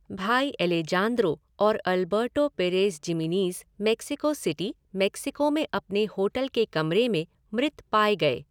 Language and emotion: Hindi, neutral